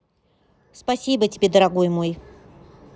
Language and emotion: Russian, neutral